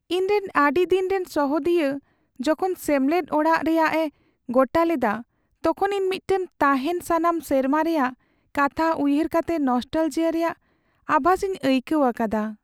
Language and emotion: Santali, sad